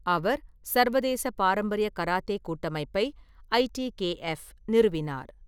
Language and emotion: Tamil, neutral